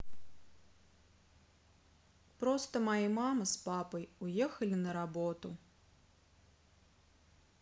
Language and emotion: Russian, sad